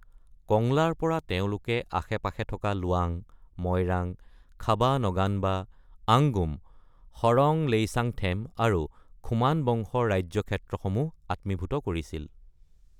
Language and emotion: Assamese, neutral